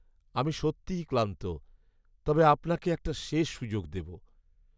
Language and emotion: Bengali, sad